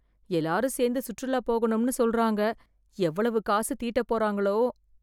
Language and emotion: Tamil, fearful